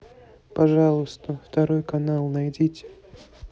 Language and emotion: Russian, neutral